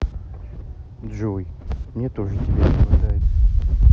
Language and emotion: Russian, sad